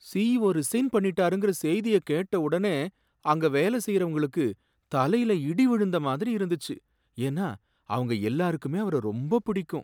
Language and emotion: Tamil, sad